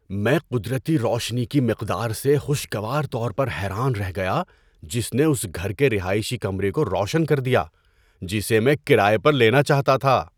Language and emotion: Urdu, surprised